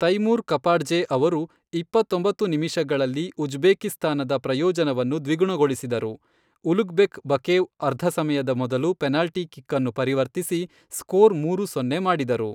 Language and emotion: Kannada, neutral